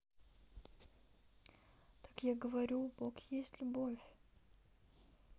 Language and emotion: Russian, sad